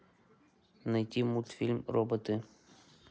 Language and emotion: Russian, neutral